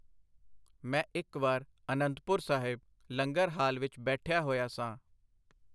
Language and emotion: Punjabi, neutral